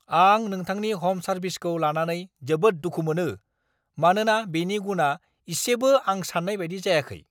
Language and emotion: Bodo, angry